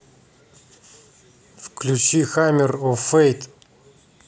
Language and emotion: Russian, neutral